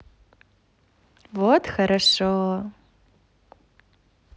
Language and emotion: Russian, positive